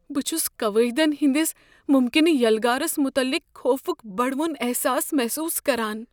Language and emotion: Kashmiri, fearful